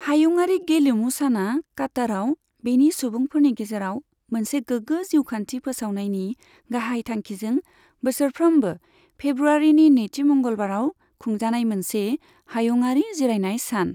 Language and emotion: Bodo, neutral